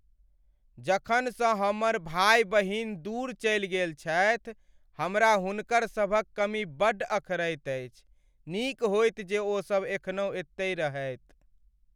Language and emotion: Maithili, sad